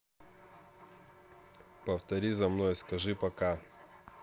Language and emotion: Russian, neutral